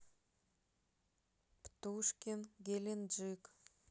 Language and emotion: Russian, neutral